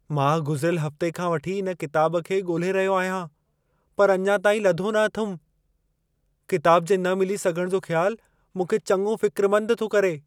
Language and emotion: Sindhi, fearful